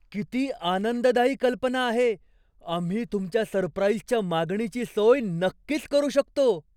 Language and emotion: Marathi, surprised